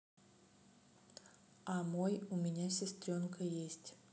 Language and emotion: Russian, neutral